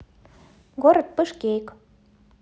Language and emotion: Russian, neutral